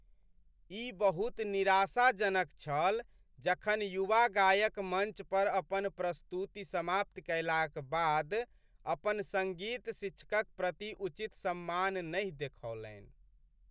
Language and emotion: Maithili, sad